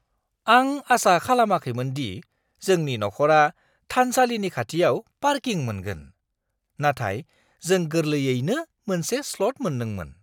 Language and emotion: Bodo, surprised